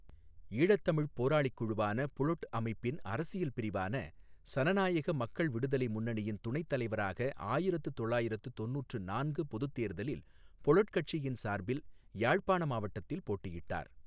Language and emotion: Tamil, neutral